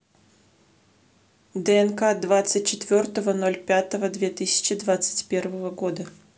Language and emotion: Russian, neutral